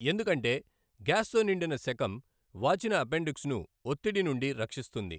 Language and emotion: Telugu, neutral